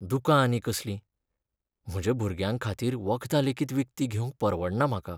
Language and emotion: Goan Konkani, sad